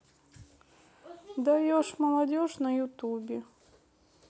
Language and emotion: Russian, neutral